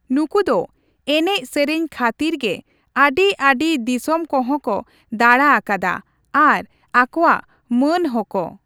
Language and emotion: Santali, neutral